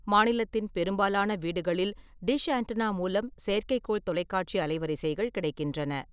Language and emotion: Tamil, neutral